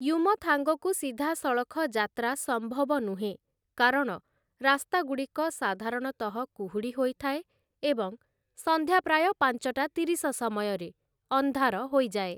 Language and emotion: Odia, neutral